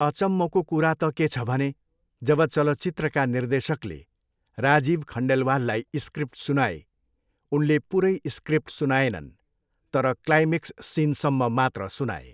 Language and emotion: Nepali, neutral